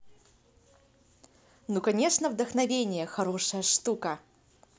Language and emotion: Russian, positive